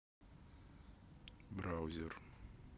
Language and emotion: Russian, neutral